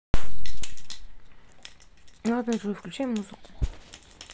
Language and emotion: Russian, neutral